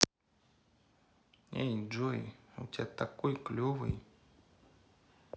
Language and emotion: Russian, neutral